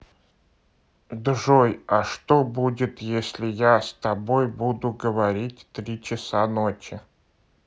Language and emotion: Russian, neutral